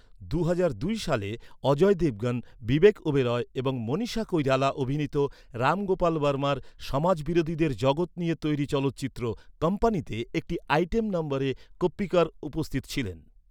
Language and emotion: Bengali, neutral